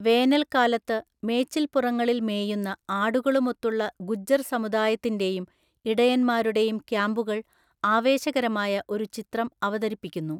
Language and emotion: Malayalam, neutral